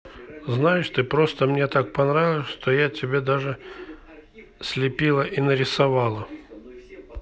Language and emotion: Russian, neutral